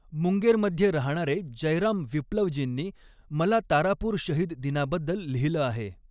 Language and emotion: Marathi, neutral